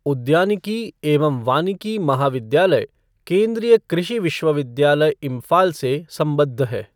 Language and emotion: Hindi, neutral